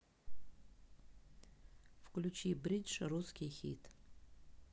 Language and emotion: Russian, neutral